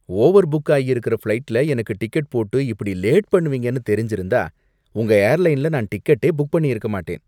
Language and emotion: Tamil, disgusted